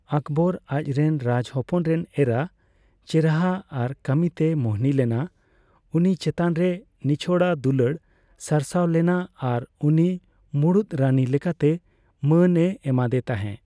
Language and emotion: Santali, neutral